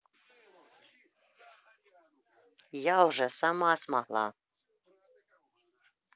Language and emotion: Russian, neutral